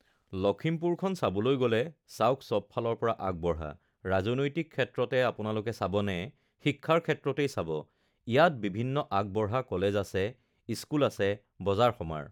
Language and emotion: Assamese, neutral